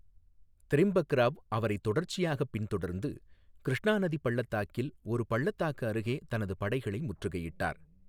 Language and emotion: Tamil, neutral